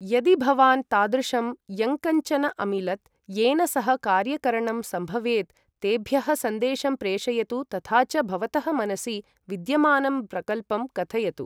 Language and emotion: Sanskrit, neutral